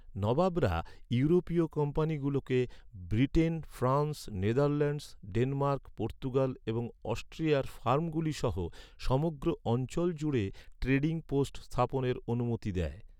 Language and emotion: Bengali, neutral